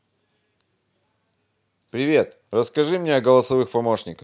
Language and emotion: Russian, positive